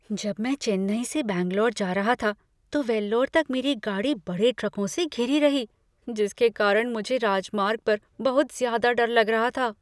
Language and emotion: Hindi, fearful